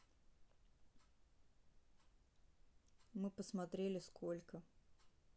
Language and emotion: Russian, neutral